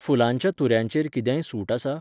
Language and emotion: Goan Konkani, neutral